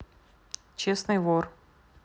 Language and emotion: Russian, neutral